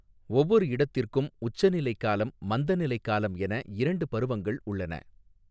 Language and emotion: Tamil, neutral